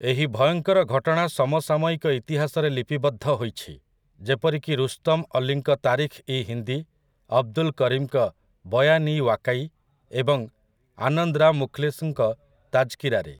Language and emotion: Odia, neutral